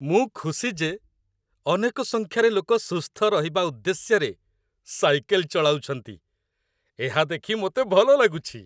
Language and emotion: Odia, happy